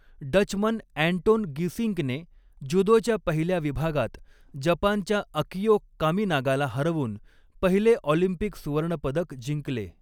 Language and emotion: Marathi, neutral